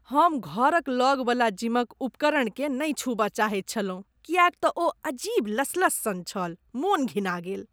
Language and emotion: Maithili, disgusted